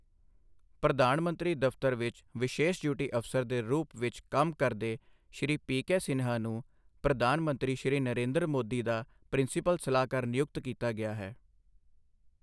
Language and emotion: Punjabi, neutral